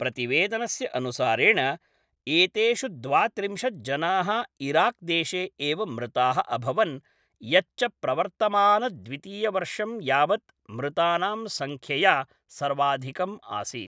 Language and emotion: Sanskrit, neutral